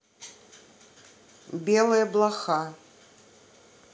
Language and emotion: Russian, neutral